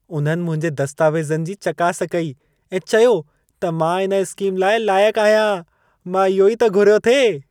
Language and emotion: Sindhi, happy